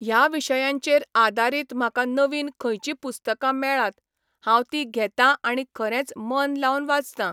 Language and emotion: Goan Konkani, neutral